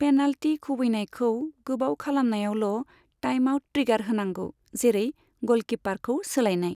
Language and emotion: Bodo, neutral